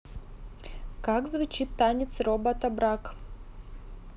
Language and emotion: Russian, neutral